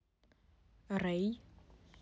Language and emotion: Russian, neutral